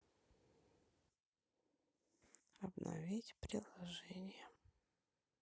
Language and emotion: Russian, sad